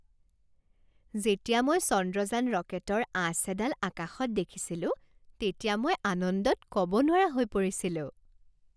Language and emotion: Assamese, happy